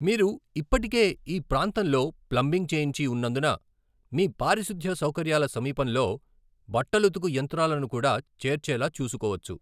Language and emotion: Telugu, neutral